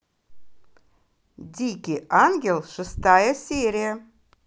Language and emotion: Russian, positive